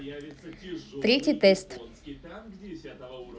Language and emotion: Russian, neutral